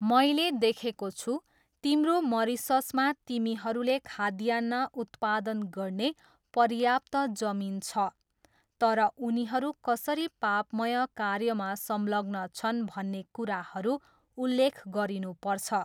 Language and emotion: Nepali, neutral